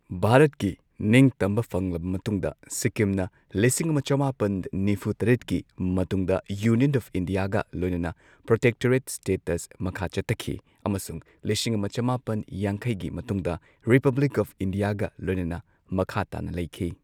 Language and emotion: Manipuri, neutral